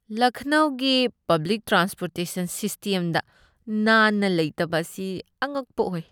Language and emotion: Manipuri, disgusted